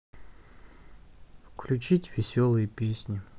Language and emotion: Russian, sad